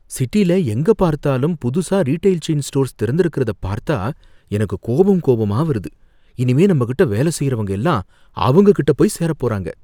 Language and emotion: Tamil, fearful